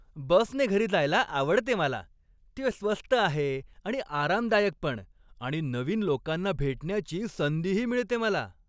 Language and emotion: Marathi, happy